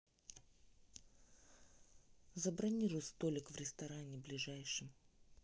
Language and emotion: Russian, neutral